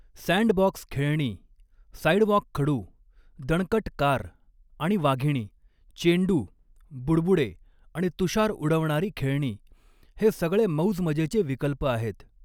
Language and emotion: Marathi, neutral